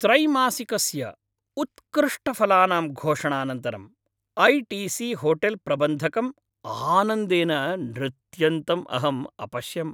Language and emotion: Sanskrit, happy